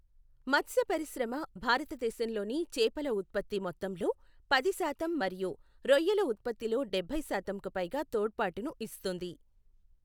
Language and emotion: Telugu, neutral